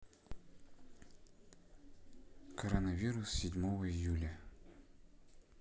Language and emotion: Russian, neutral